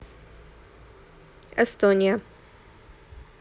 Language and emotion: Russian, neutral